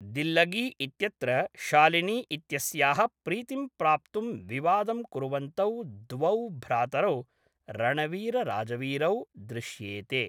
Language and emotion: Sanskrit, neutral